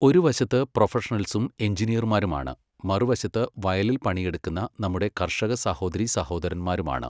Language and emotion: Malayalam, neutral